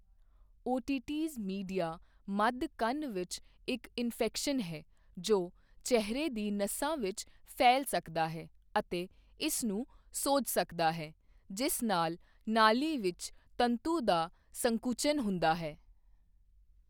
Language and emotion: Punjabi, neutral